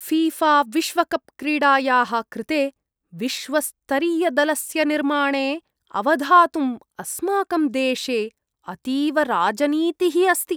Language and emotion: Sanskrit, disgusted